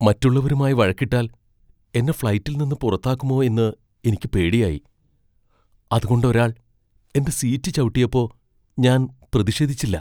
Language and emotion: Malayalam, fearful